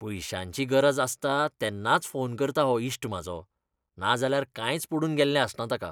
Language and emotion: Goan Konkani, disgusted